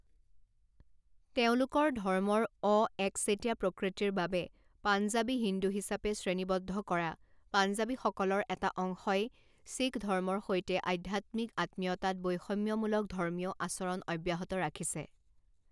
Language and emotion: Assamese, neutral